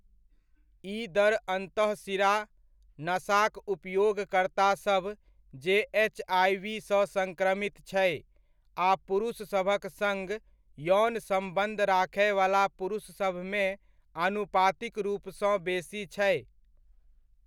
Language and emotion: Maithili, neutral